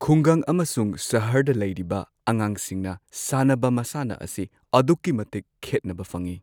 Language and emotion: Manipuri, neutral